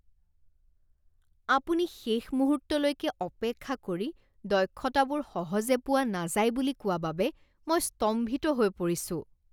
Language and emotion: Assamese, disgusted